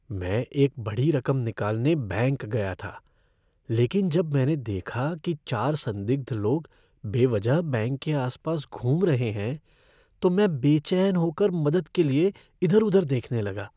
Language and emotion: Hindi, fearful